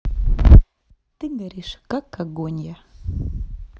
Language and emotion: Russian, neutral